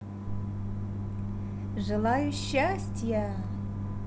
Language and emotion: Russian, positive